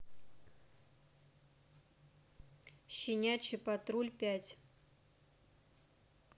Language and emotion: Russian, neutral